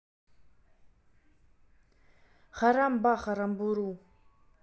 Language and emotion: Russian, neutral